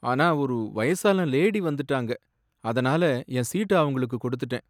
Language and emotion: Tamil, sad